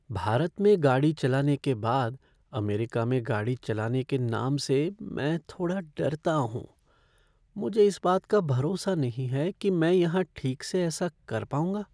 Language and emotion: Hindi, fearful